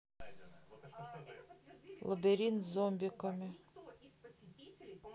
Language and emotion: Russian, neutral